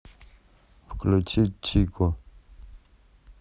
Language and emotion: Russian, neutral